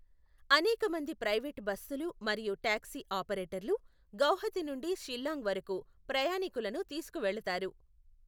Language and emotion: Telugu, neutral